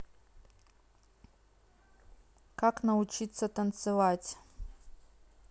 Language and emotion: Russian, neutral